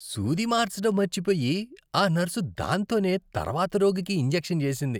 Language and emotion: Telugu, disgusted